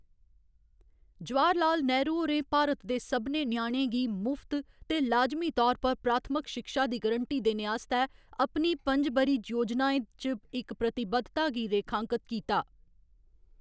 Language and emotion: Dogri, neutral